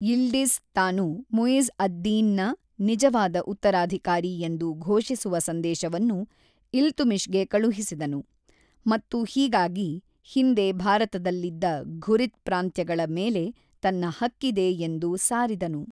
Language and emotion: Kannada, neutral